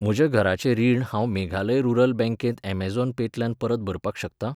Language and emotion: Goan Konkani, neutral